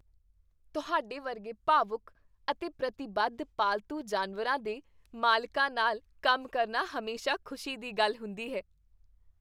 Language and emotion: Punjabi, happy